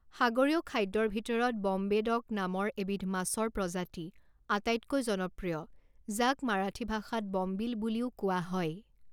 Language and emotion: Assamese, neutral